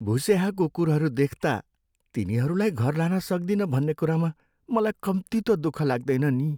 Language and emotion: Nepali, sad